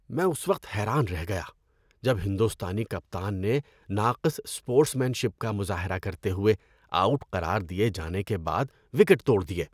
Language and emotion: Urdu, disgusted